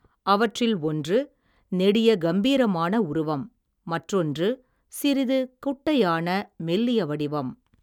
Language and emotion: Tamil, neutral